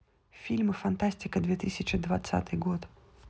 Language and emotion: Russian, neutral